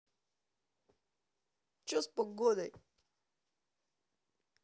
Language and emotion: Russian, angry